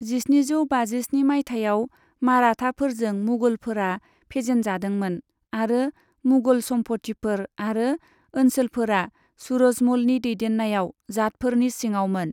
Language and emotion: Bodo, neutral